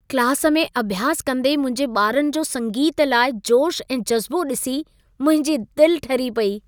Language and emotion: Sindhi, happy